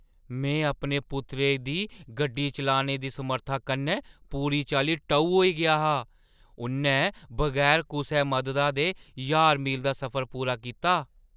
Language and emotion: Dogri, surprised